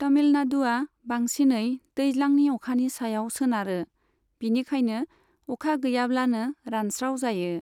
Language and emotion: Bodo, neutral